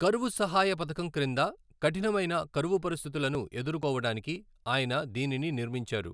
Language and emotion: Telugu, neutral